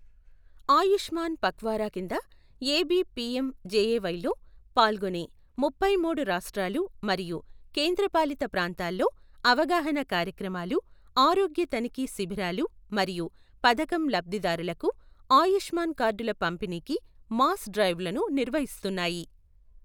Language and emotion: Telugu, neutral